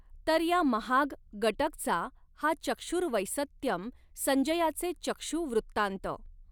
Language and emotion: Marathi, neutral